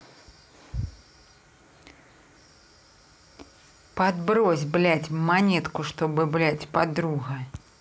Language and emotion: Russian, angry